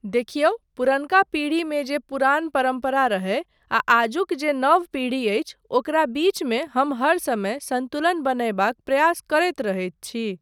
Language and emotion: Maithili, neutral